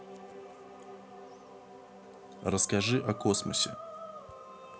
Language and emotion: Russian, neutral